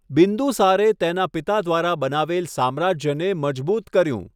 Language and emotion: Gujarati, neutral